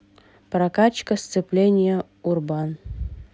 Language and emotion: Russian, neutral